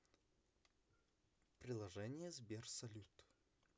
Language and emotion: Russian, neutral